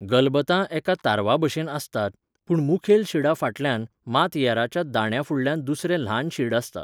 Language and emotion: Goan Konkani, neutral